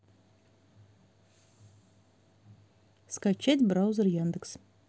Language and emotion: Russian, neutral